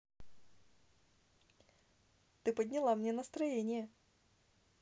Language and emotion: Russian, positive